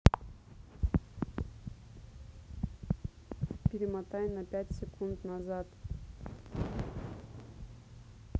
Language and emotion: Russian, neutral